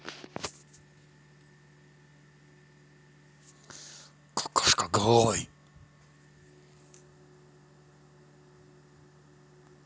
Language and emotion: Russian, angry